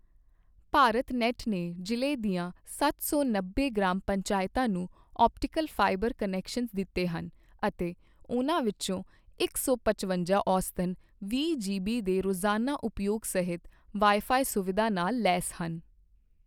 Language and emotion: Punjabi, neutral